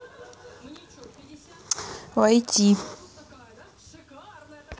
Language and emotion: Russian, neutral